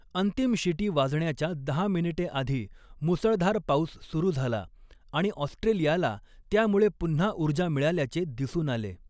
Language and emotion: Marathi, neutral